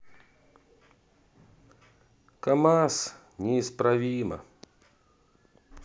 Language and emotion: Russian, sad